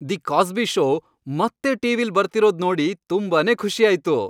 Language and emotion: Kannada, happy